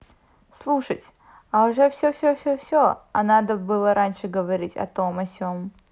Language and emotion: Russian, neutral